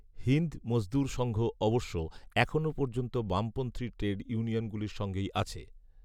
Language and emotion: Bengali, neutral